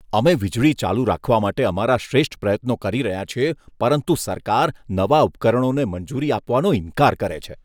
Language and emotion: Gujarati, disgusted